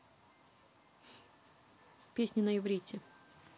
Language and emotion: Russian, neutral